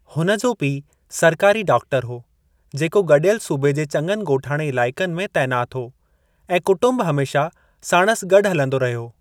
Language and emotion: Sindhi, neutral